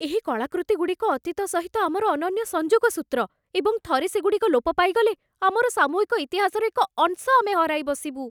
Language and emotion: Odia, fearful